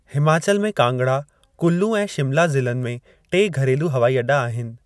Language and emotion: Sindhi, neutral